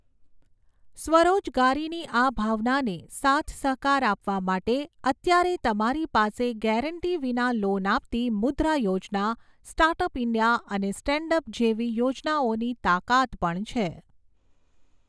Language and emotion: Gujarati, neutral